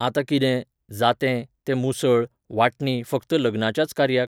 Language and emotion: Goan Konkani, neutral